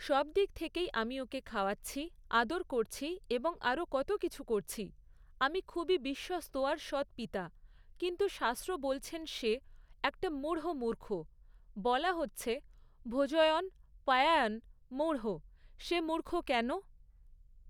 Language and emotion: Bengali, neutral